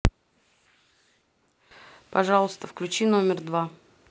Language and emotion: Russian, neutral